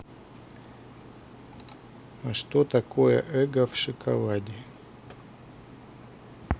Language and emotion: Russian, neutral